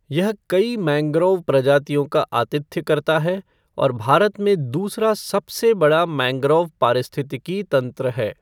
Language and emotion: Hindi, neutral